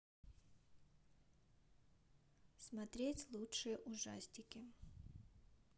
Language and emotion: Russian, neutral